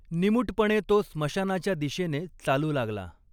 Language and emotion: Marathi, neutral